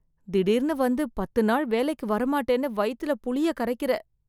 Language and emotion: Tamil, fearful